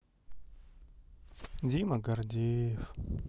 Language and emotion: Russian, sad